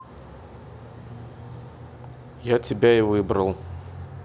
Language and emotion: Russian, neutral